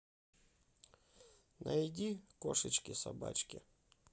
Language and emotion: Russian, neutral